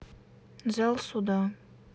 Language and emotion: Russian, neutral